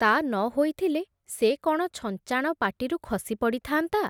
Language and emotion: Odia, neutral